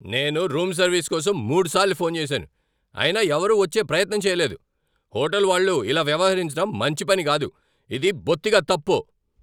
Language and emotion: Telugu, angry